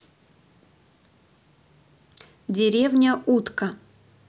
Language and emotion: Russian, neutral